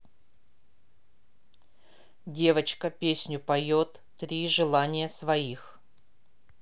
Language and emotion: Russian, neutral